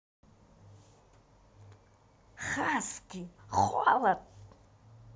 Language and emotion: Russian, positive